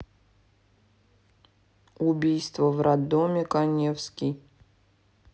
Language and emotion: Russian, neutral